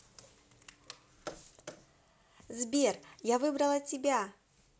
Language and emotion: Russian, positive